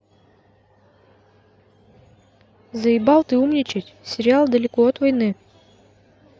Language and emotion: Russian, neutral